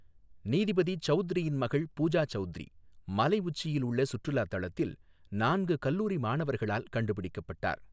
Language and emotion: Tamil, neutral